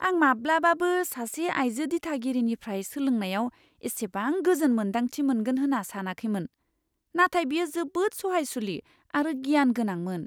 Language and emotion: Bodo, surprised